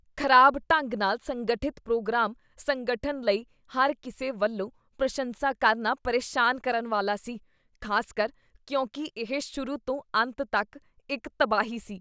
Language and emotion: Punjabi, disgusted